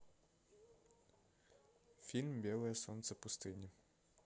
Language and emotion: Russian, neutral